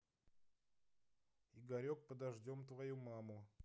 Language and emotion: Russian, neutral